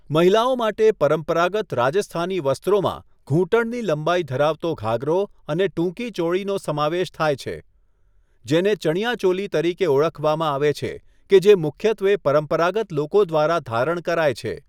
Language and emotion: Gujarati, neutral